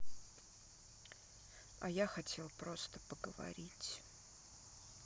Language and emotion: Russian, sad